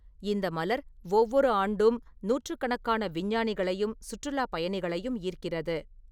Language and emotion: Tamil, neutral